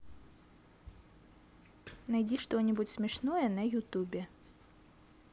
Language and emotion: Russian, positive